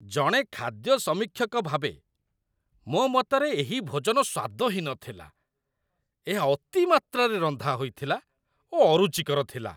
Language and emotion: Odia, disgusted